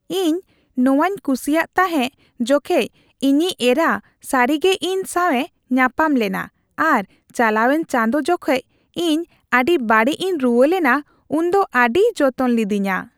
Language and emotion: Santali, happy